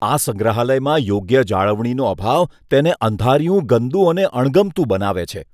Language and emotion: Gujarati, disgusted